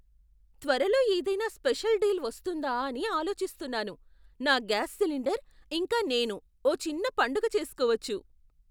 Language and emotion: Telugu, surprised